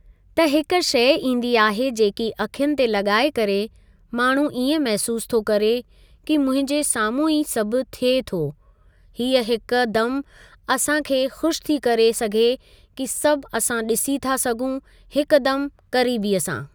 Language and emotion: Sindhi, neutral